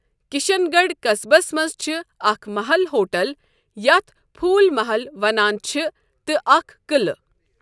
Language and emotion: Kashmiri, neutral